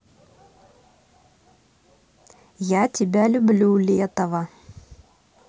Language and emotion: Russian, neutral